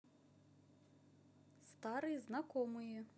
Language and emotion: Russian, neutral